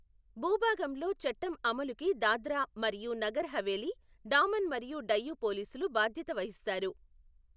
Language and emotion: Telugu, neutral